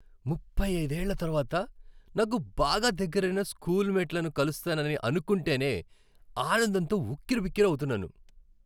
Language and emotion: Telugu, happy